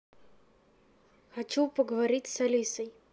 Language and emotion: Russian, neutral